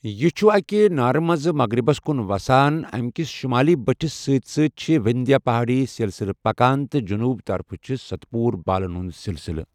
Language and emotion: Kashmiri, neutral